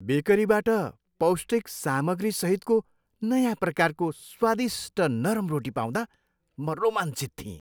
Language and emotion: Nepali, happy